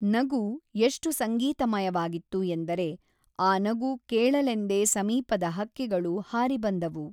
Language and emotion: Kannada, neutral